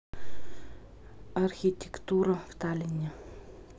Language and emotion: Russian, neutral